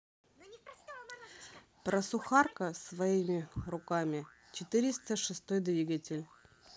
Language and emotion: Russian, neutral